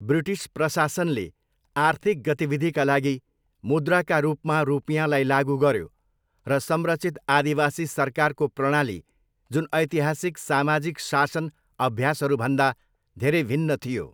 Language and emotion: Nepali, neutral